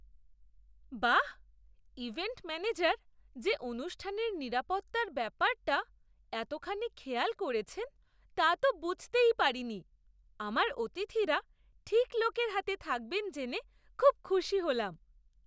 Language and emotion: Bengali, surprised